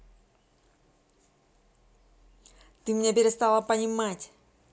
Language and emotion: Russian, angry